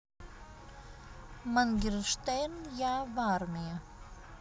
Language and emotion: Russian, neutral